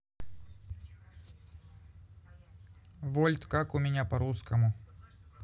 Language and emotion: Russian, neutral